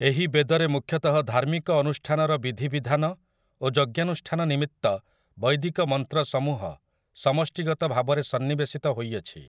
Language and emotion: Odia, neutral